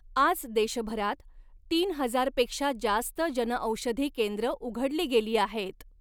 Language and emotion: Marathi, neutral